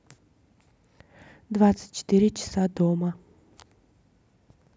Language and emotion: Russian, neutral